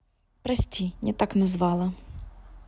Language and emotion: Russian, neutral